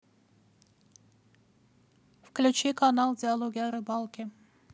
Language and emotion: Russian, neutral